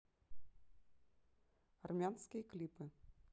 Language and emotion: Russian, neutral